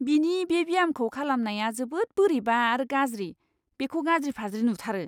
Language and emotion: Bodo, disgusted